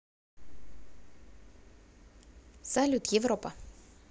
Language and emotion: Russian, positive